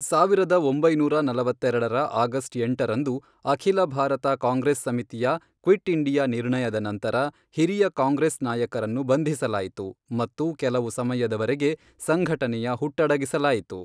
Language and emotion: Kannada, neutral